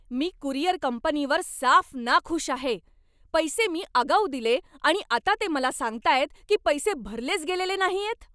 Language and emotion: Marathi, angry